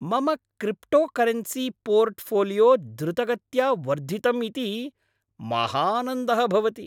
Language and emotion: Sanskrit, happy